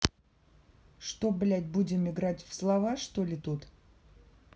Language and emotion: Russian, angry